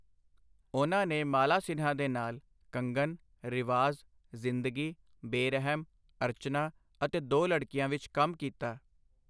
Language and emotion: Punjabi, neutral